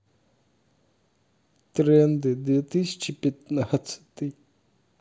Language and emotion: Russian, sad